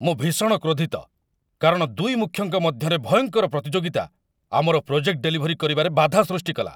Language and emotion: Odia, angry